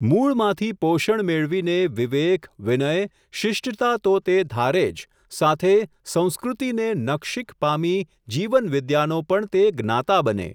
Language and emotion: Gujarati, neutral